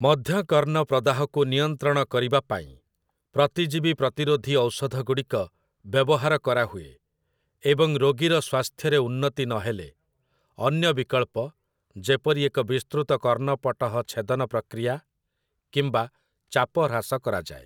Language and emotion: Odia, neutral